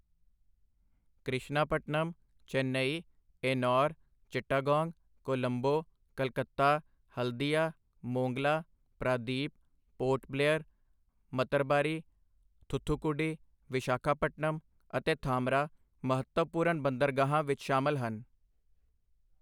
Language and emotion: Punjabi, neutral